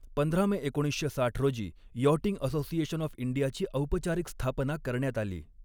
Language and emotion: Marathi, neutral